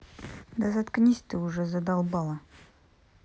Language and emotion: Russian, angry